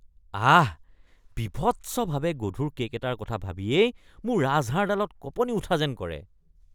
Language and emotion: Assamese, disgusted